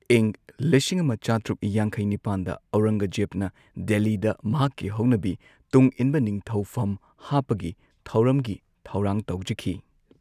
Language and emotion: Manipuri, neutral